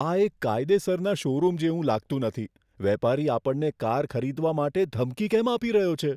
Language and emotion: Gujarati, fearful